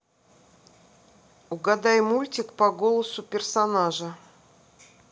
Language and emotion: Russian, neutral